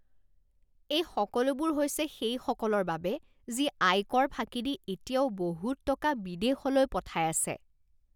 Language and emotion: Assamese, disgusted